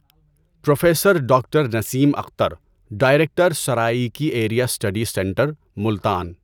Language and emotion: Urdu, neutral